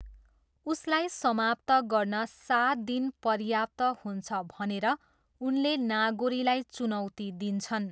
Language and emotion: Nepali, neutral